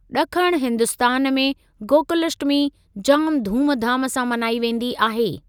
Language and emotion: Sindhi, neutral